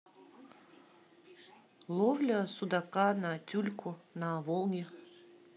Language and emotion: Russian, neutral